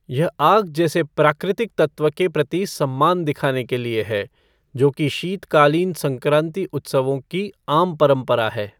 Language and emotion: Hindi, neutral